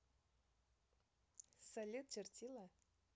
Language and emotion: Russian, positive